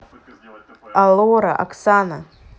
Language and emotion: Russian, neutral